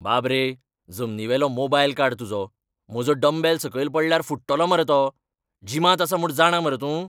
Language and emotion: Goan Konkani, angry